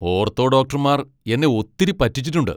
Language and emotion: Malayalam, angry